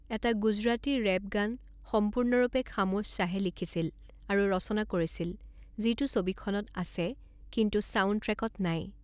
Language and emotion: Assamese, neutral